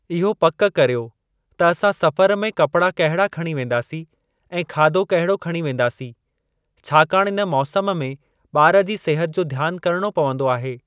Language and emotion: Sindhi, neutral